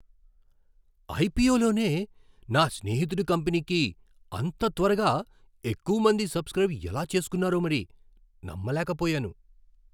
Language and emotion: Telugu, surprised